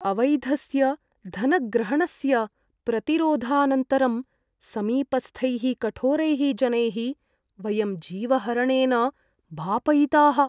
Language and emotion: Sanskrit, fearful